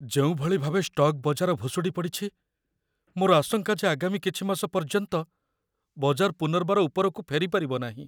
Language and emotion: Odia, fearful